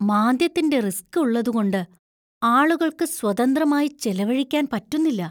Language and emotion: Malayalam, fearful